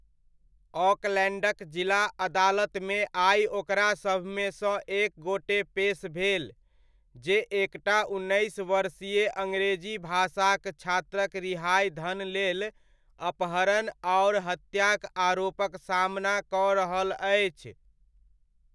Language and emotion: Maithili, neutral